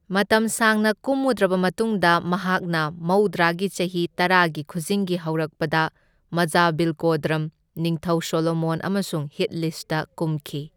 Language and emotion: Manipuri, neutral